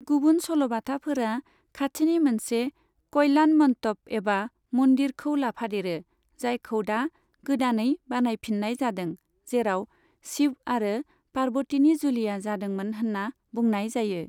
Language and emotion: Bodo, neutral